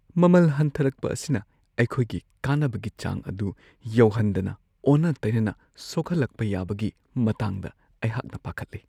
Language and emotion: Manipuri, fearful